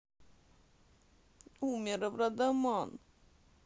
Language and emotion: Russian, sad